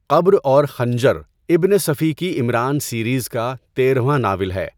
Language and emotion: Urdu, neutral